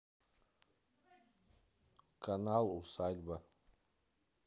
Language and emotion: Russian, neutral